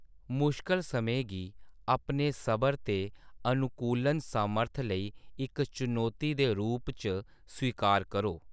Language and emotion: Dogri, neutral